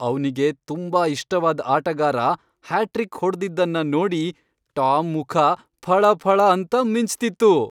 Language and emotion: Kannada, happy